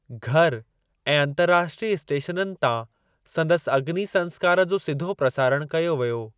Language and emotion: Sindhi, neutral